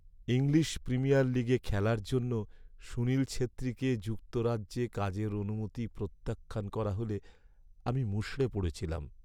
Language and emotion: Bengali, sad